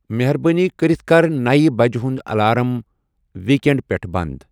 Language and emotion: Kashmiri, neutral